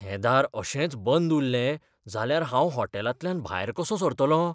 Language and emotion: Goan Konkani, fearful